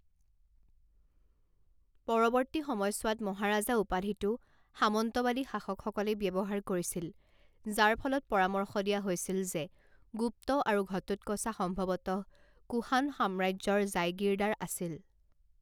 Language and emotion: Assamese, neutral